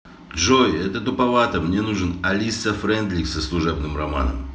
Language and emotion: Russian, neutral